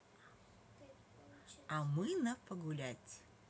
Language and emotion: Russian, positive